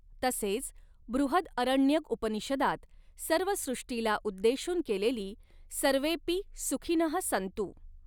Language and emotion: Marathi, neutral